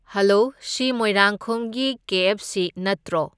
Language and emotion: Manipuri, neutral